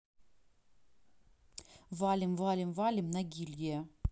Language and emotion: Russian, neutral